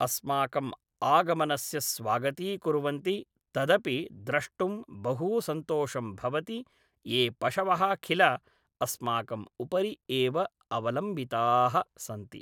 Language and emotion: Sanskrit, neutral